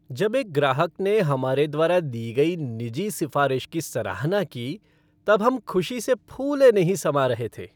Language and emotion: Hindi, happy